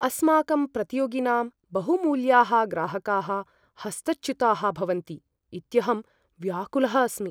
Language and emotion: Sanskrit, fearful